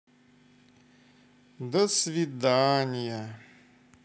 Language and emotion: Russian, sad